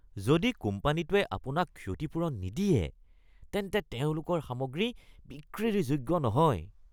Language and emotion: Assamese, disgusted